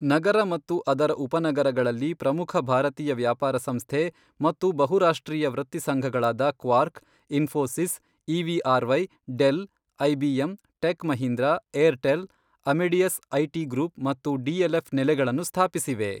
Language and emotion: Kannada, neutral